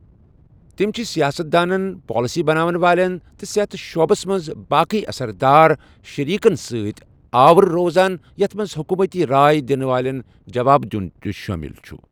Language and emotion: Kashmiri, neutral